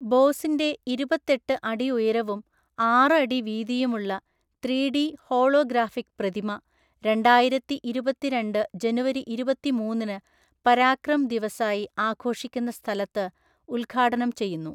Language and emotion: Malayalam, neutral